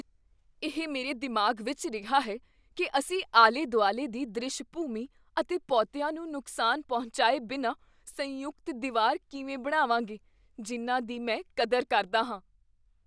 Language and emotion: Punjabi, fearful